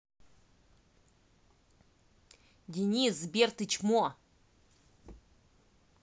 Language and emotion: Russian, angry